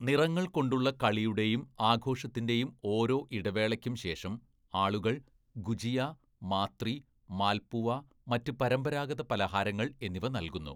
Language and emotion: Malayalam, neutral